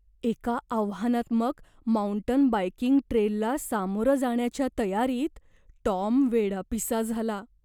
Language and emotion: Marathi, fearful